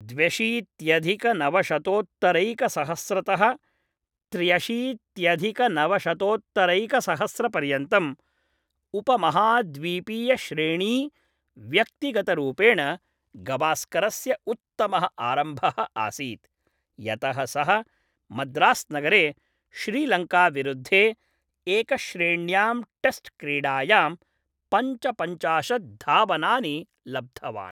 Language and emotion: Sanskrit, neutral